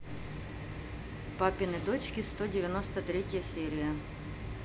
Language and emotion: Russian, neutral